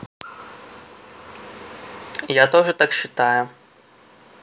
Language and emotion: Russian, neutral